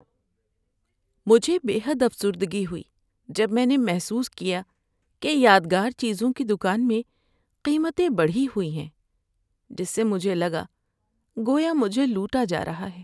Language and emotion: Urdu, sad